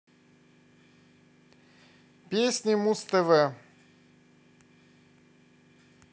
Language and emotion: Russian, positive